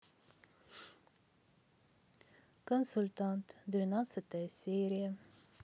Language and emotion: Russian, sad